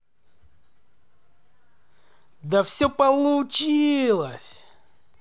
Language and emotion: Russian, positive